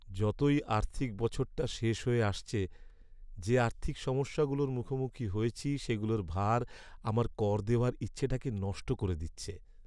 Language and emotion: Bengali, sad